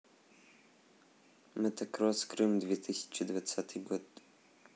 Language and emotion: Russian, neutral